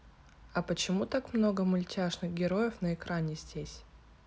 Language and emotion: Russian, neutral